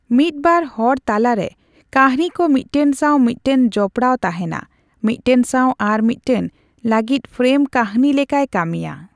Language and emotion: Santali, neutral